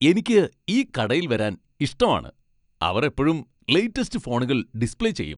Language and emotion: Malayalam, happy